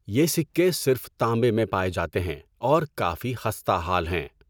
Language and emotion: Urdu, neutral